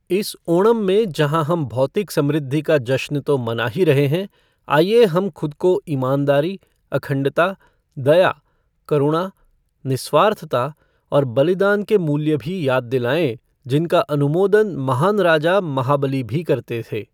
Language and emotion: Hindi, neutral